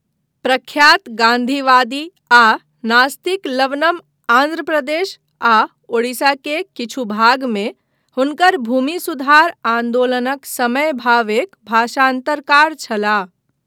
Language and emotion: Maithili, neutral